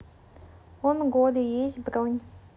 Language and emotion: Russian, neutral